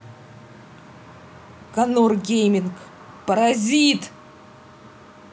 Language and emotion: Russian, angry